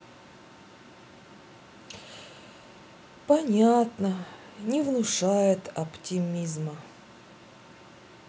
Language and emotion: Russian, sad